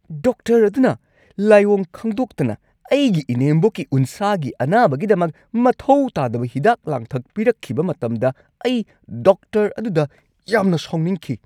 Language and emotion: Manipuri, angry